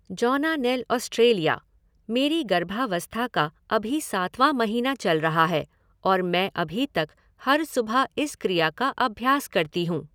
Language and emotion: Hindi, neutral